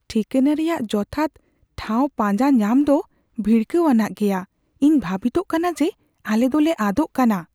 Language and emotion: Santali, fearful